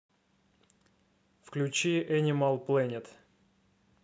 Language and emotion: Russian, neutral